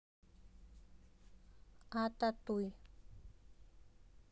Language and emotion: Russian, neutral